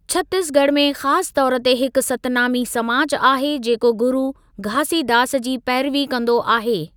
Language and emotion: Sindhi, neutral